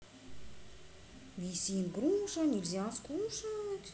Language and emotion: Russian, neutral